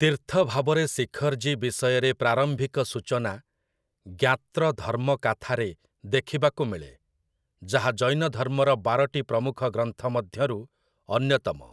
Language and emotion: Odia, neutral